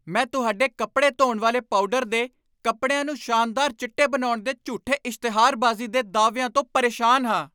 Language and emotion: Punjabi, angry